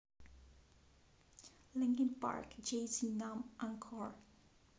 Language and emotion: Russian, neutral